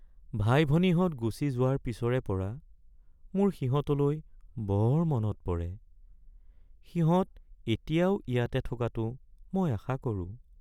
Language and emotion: Assamese, sad